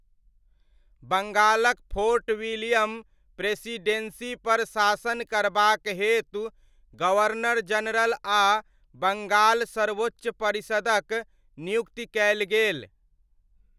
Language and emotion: Maithili, neutral